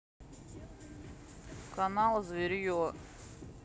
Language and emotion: Russian, neutral